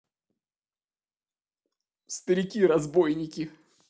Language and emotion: Russian, sad